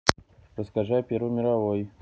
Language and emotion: Russian, neutral